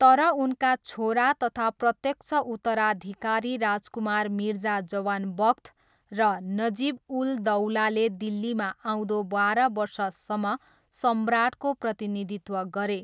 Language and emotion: Nepali, neutral